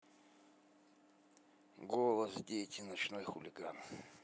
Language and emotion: Russian, neutral